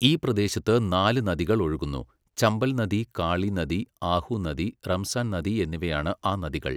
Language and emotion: Malayalam, neutral